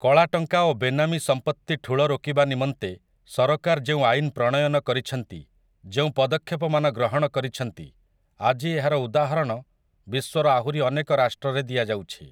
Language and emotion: Odia, neutral